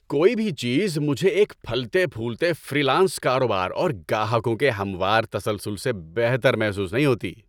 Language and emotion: Urdu, happy